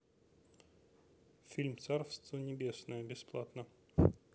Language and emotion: Russian, neutral